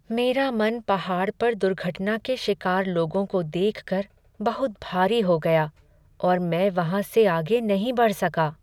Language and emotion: Hindi, sad